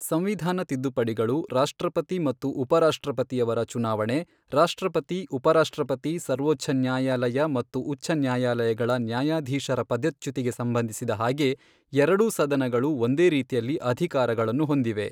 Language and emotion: Kannada, neutral